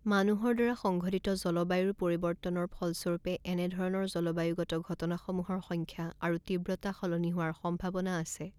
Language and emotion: Assamese, neutral